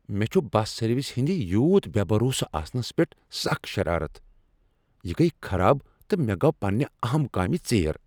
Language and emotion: Kashmiri, angry